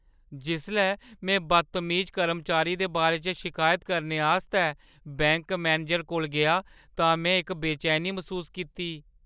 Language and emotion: Dogri, fearful